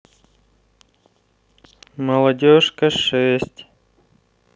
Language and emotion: Russian, neutral